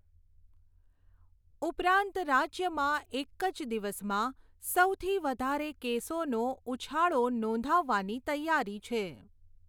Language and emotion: Gujarati, neutral